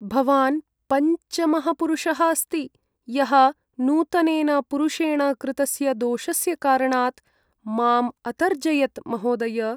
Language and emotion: Sanskrit, sad